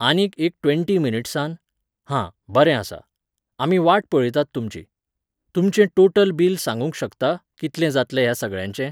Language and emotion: Goan Konkani, neutral